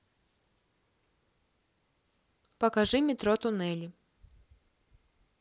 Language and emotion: Russian, neutral